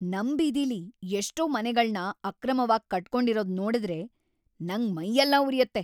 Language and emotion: Kannada, angry